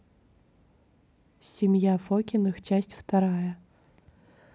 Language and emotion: Russian, neutral